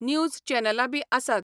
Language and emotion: Goan Konkani, neutral